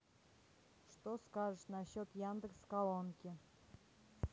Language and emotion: Russian, neutral